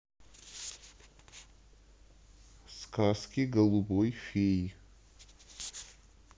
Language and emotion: Russian, neutral